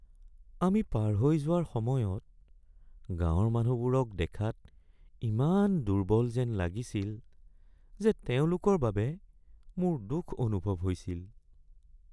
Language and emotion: Assamese, sad